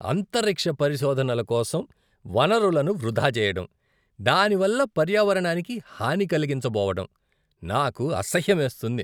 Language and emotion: Telugu, disgusted